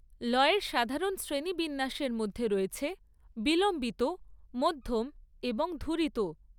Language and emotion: Bengali, neutral